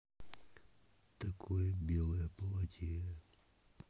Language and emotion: Russian, neutral